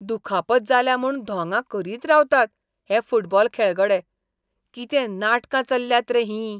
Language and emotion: Goan Konkani, disgusted